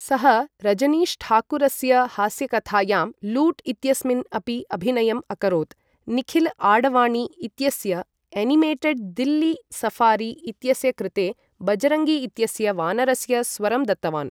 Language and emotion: Sanskrit, neutral